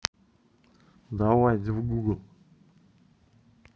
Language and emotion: Russian, neutral